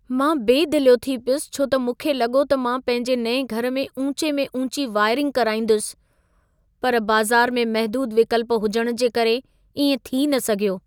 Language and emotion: Sindhi, sad